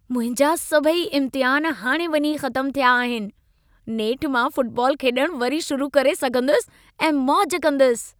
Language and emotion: Sindhi, happy